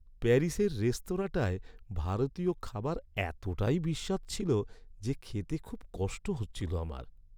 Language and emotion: Bengali, sad